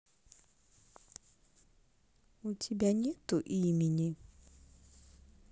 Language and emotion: Russian, neutral